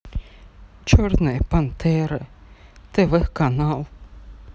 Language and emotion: Russian, sad